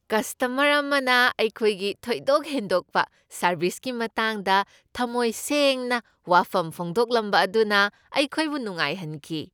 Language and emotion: Manipuri, happy